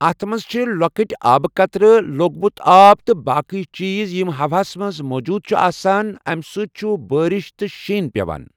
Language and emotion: Kashmiri, neutral